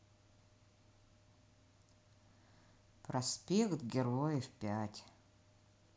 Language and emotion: Russian, sad